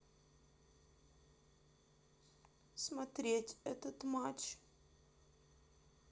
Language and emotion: Russian, sad